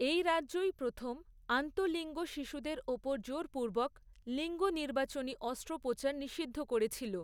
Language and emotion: Bengali, neutral